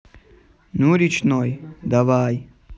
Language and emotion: Russian, neutral